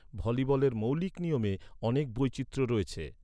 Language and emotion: Bengali, neutral